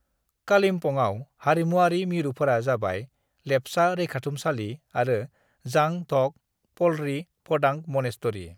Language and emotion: Bodo, neutral